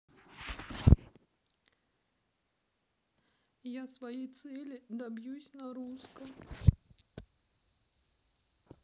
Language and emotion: Russian, sad